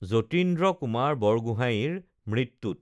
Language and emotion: Assamese, neutral